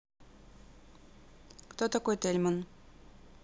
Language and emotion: Russian, neutral